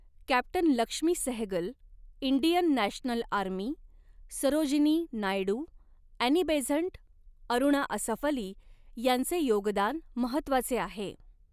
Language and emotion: Marathi, neutral